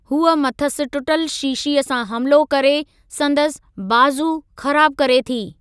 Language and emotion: Sindhi, neutral